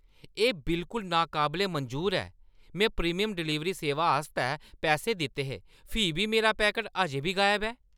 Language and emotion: Dogri, angry